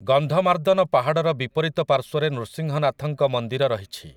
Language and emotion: Odia, neutral